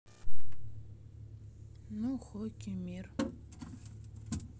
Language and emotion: Russian, neutral